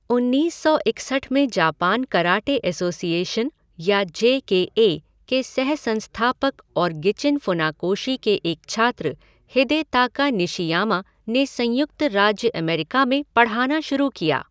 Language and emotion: Hindi, neutral